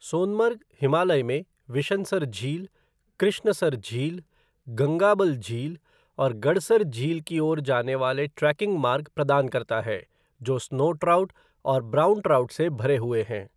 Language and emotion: Hindi, neutral